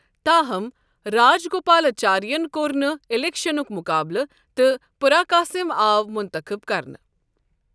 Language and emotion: Kashmiri, neutral